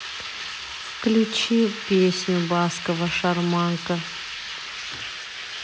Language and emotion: Russian, neutral